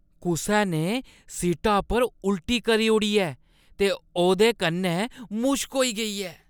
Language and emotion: Dogri, disgusted